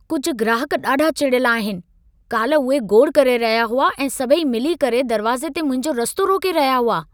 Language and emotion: Sindhi, angry